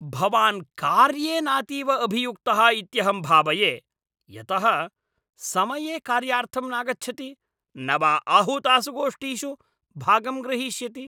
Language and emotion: Sanskrit, angry